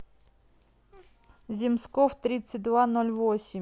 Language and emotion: Russian, neutral